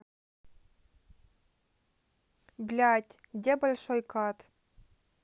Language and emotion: Russian, neutral